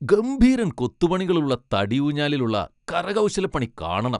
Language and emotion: Malayalam, happy